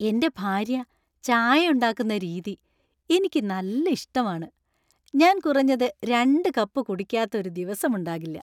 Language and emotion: Malayalam, happy